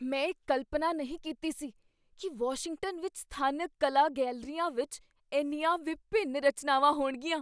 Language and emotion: Punjabi, surprised